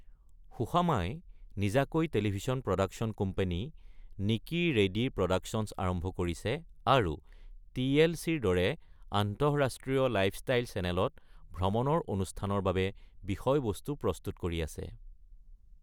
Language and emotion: Assamese, neutral